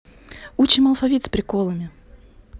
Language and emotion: Russian, neutral